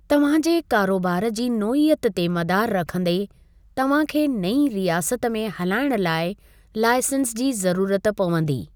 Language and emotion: Sindhi, neutral